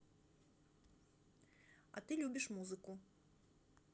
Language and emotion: Russian, neutral